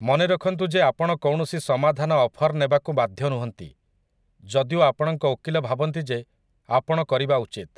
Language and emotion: Odia, neutral